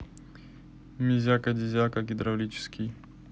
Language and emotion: Russian, neutral